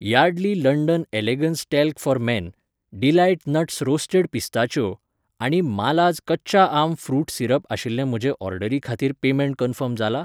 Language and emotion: Goan Konkani, neutral